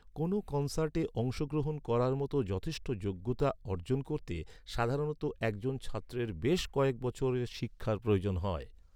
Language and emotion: Bengali, neutral